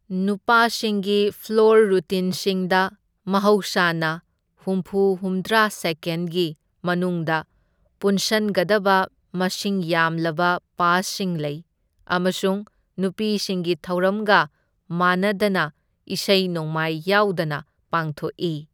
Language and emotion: Manipuri, neutral